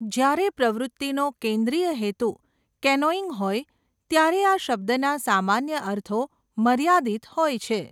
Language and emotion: Gujarati, neutral